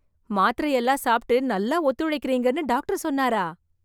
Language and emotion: Tamil, surprised